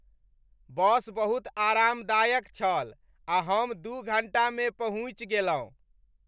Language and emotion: Maithili, happy